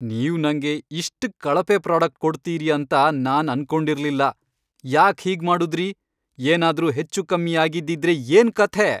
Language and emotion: Kannada, angry